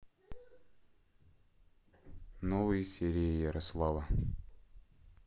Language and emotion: Russian, neutral